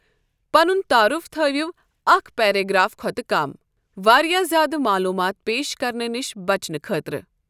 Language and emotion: Kashmiri, neutral